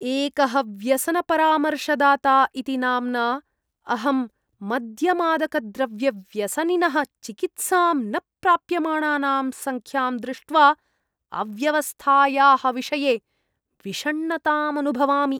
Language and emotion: Sanskrit, disgusted